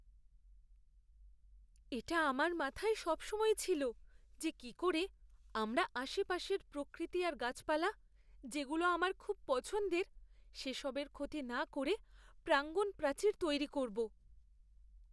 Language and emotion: Bengali, fearful